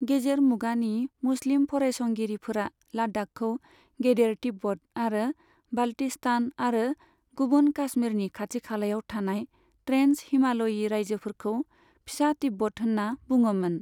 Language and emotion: Bodo, neutral